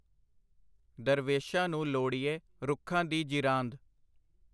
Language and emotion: Punjabi, neutral